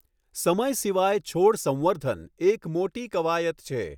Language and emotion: Gujarati, neutral